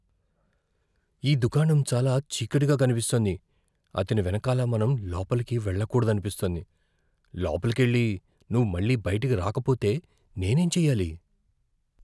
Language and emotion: Telugu, fearful